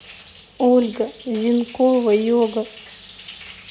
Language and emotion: Russian, sad